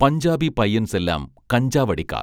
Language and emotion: Malayalam, neutral